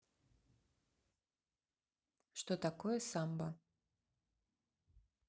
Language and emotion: Russian, neutral